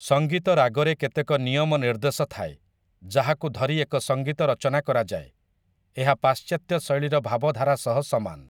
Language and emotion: Odia, neutral